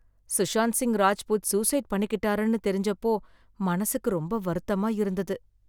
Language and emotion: Tamil, sad